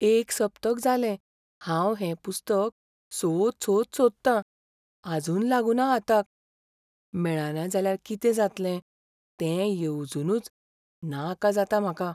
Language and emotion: Goan Konkani, fearful